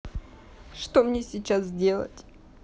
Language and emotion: Russian, sad